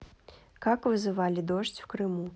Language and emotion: Russian, neutral